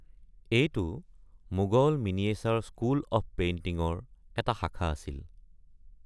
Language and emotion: Assamese, neutral